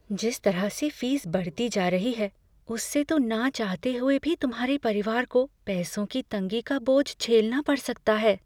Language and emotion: Hindi, fearful